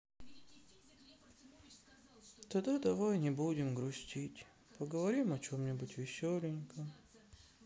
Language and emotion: Russian, sad